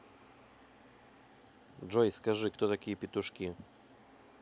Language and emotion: Russian, neutral